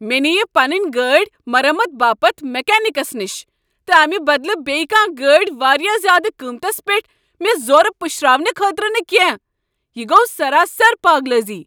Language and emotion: Kashmiri, angry